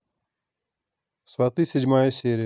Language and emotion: Russian, neutral